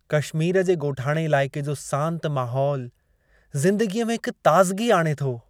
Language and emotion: Sindhi, happy